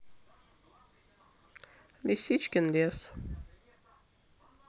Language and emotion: Russian, neutral